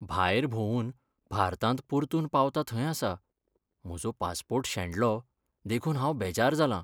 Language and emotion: Goan Konkani, sad